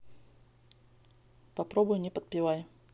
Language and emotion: Russian, neutral